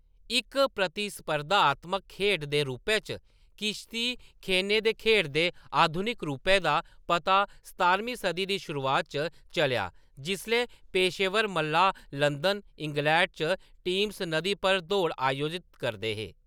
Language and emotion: Dogri, neutral